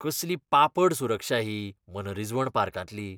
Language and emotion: Goan Konkani, disgusted